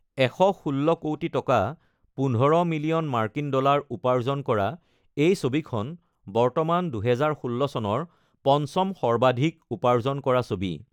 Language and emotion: Assamese, neutral